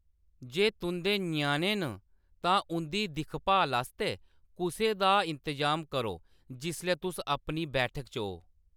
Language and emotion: Dogri, neutral